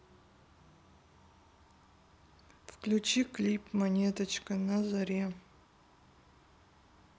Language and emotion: Russian, sad